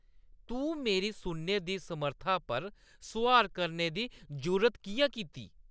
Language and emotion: Dogri, angry